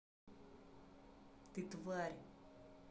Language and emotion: Russian, angry